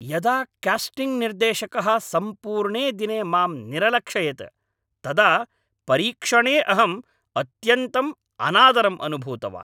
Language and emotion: Sanskrit, angry